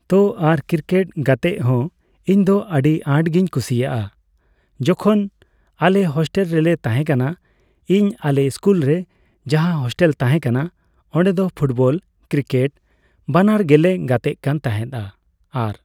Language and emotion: Santali, neutral